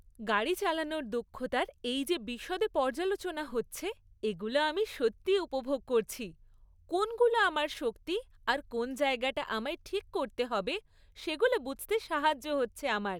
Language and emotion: Bengali, happy